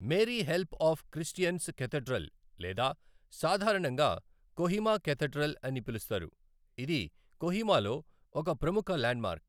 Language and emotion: Telugu, neutral